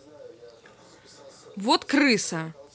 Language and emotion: Russian, angry